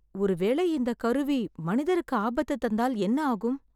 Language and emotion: Tamil, fearful